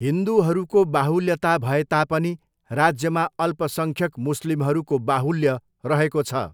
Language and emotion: Nepali, neutral